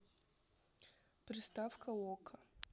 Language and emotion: Russian, neutral